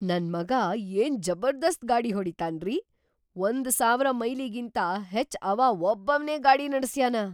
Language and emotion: Kannada, surprised